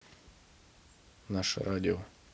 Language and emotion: Russian, neutral